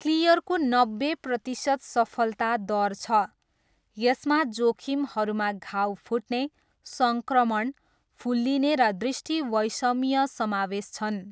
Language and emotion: Nepali, neutral